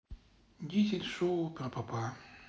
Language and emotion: Russian, sad